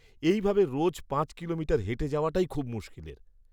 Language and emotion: Bengali, disgusted